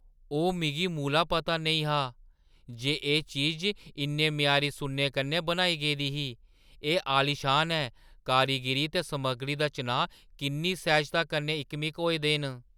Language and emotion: Dogri, surprised